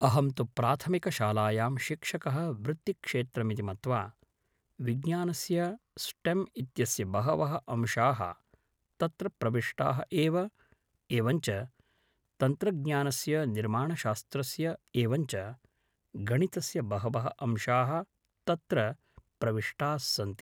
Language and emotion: Sanskrit, neutral